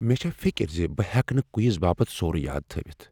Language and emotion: Kashmiri, fearful